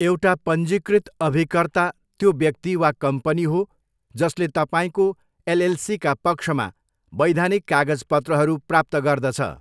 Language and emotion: Nepali, neutral